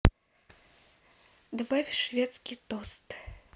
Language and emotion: Russian, neutral